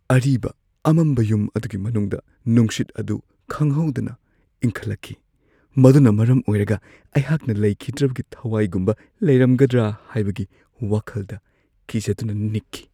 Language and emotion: Manipuri, fearful